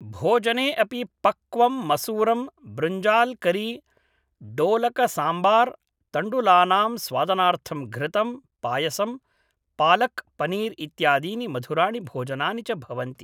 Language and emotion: Sanskrit, neutral